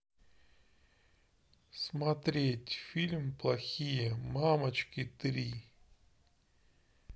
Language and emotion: Russian, neutral